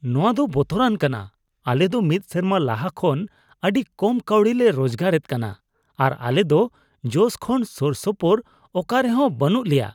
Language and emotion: Santali, disgusted